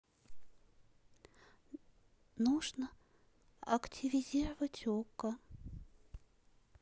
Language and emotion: Russian, sad